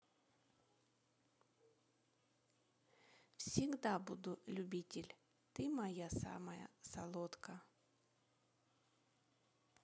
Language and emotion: Russian, neutral